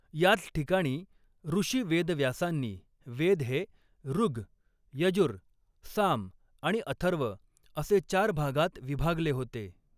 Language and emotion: Marathi, neutral